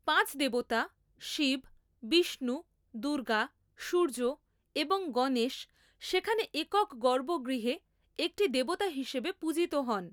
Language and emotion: Bengali, neutral